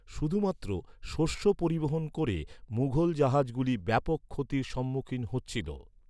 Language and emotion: Bengali, neutral